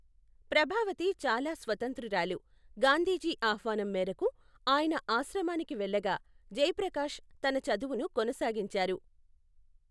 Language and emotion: Telugu, neutral